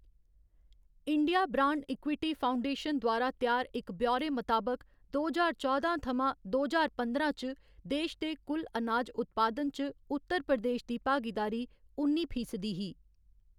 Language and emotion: Dogri, neutral